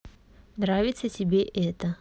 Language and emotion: Russian, neutral